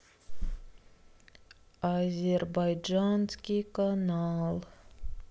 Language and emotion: Russian, sad